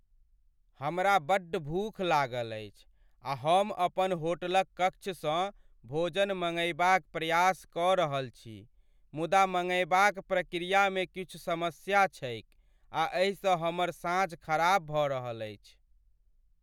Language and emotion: Maithili, sad